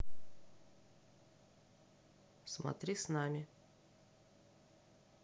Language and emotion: Russian, neutral